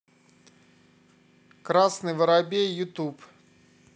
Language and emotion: Russian, neutral